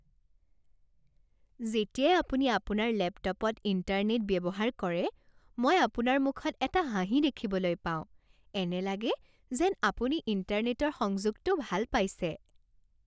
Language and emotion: Assamese, happy